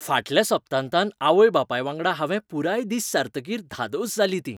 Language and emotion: Goan Konkani, happy